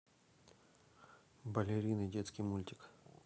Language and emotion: Russian, neutral